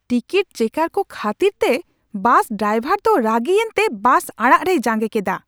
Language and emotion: Santali, angry